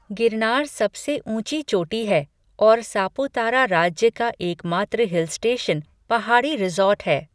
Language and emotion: Hindi, neutral